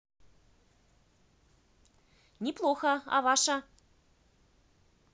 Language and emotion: Russian, positive